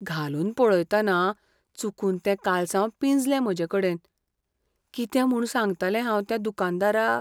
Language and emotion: Goan Konkani, fearful